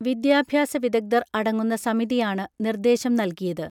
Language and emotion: Malayalam, neutral